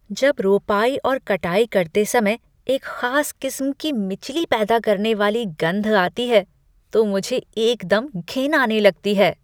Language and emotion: Hindi, disgusted